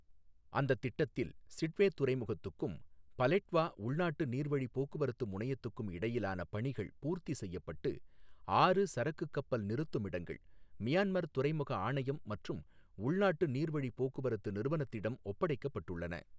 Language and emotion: Tamil, neutral